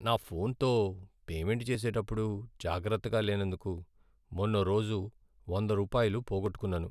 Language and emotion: Telugu, sad